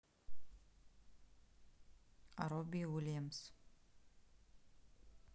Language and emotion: Russian, neutral